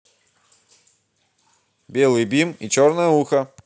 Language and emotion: Russian, positive